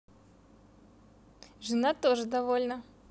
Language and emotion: Russian, positive